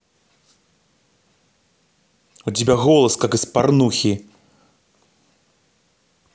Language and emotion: Russian, angry